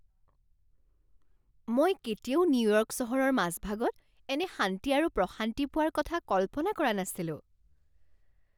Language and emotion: Assamese, surprised